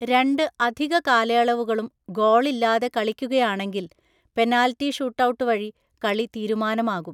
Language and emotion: Malayalam, neutral